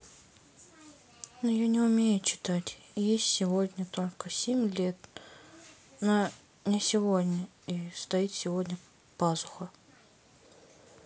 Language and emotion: Russian, sad